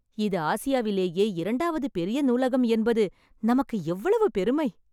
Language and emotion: Tamil, happy